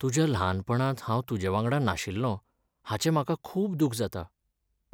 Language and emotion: Goan Konkani, sad